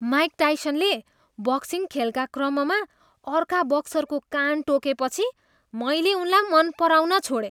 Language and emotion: Nepali, disgusted